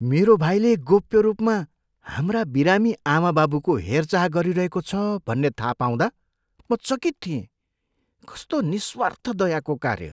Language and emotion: Nepali, surprised